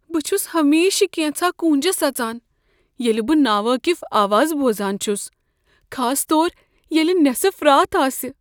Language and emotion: Kashmiri, fearful